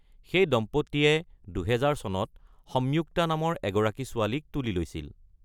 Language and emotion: Assamese, neutral